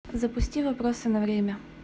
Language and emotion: Russian, neutral